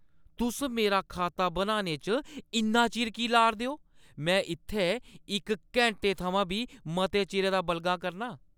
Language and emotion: Dogri, angry